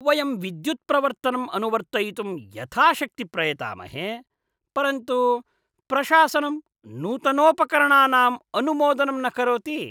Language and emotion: Sanskrit, disgusted